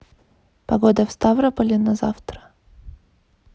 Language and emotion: Russian, neutral